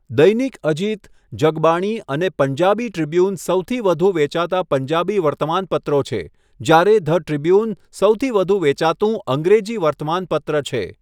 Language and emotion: Gujarati, neutral